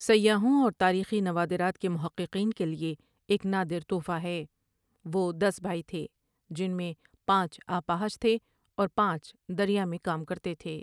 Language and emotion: Urdu, neutral